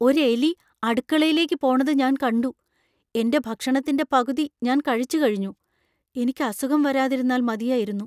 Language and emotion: Malayalam, fearful